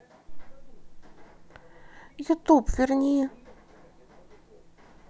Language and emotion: Russian, sad